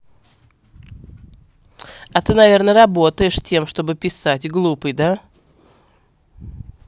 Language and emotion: Russian, angry